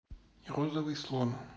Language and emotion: Russian, neutral